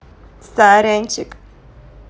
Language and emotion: Russian, positive